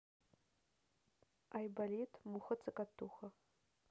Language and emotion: Russian, neutral